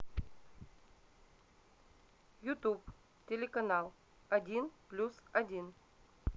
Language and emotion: Russian, neutral